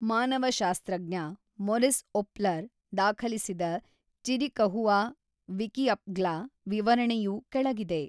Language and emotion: Kannada, neutral